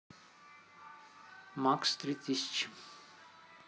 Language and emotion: Russian, neutral